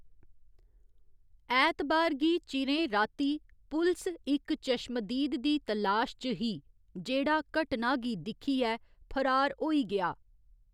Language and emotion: Dogri, neutral